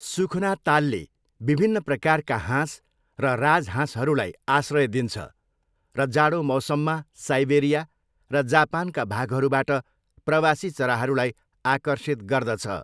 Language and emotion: Nepali, neutral